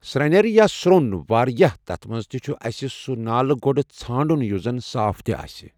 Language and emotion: Kashmiri, neutral